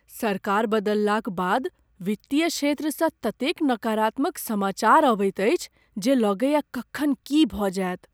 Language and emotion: Maithili, fearful